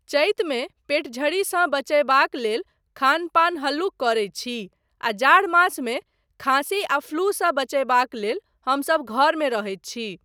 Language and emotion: Maithili, neutral